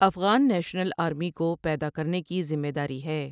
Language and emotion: Urdu, neutral